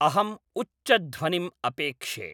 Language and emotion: Sanskrit, neutral